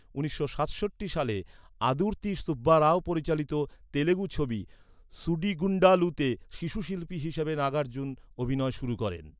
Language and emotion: Bengali, neutral